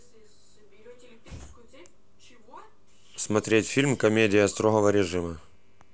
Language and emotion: Russian, neutral